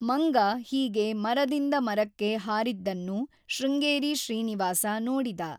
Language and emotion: Kannada, neutral